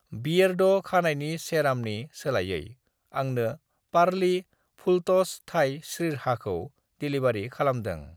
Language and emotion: Bodo, neutral